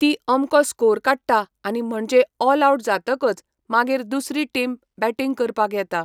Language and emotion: Goan Konkani, neutral